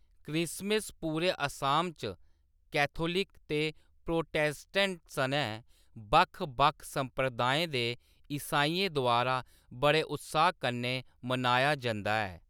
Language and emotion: Dogri, neutral